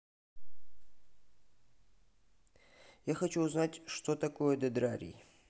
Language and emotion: Russian, neutral